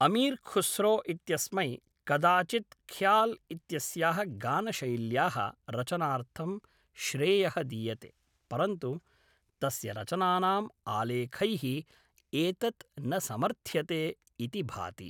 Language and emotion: Sanskrit, neutral